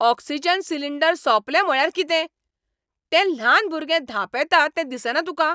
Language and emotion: Goan Konkani, angry